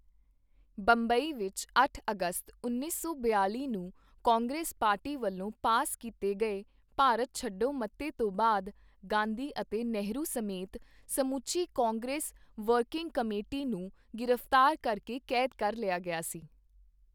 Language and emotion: Punjabi, neutral